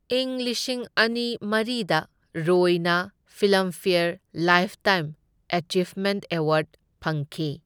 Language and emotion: Manipuri, neutral